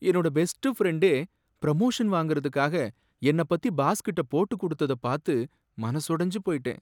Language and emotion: Tamil, sad